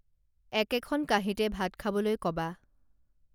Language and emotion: Assamese, neutral